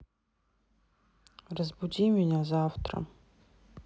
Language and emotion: Russian, neutral